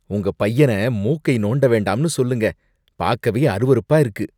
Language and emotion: Tamil, disgusted